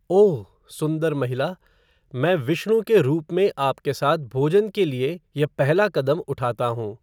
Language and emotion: Hindi, neutral